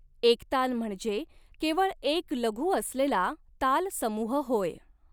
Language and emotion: Marathi, neutral